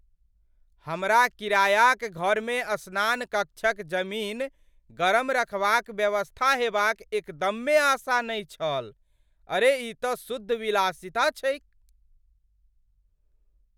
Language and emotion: Maithili, surprised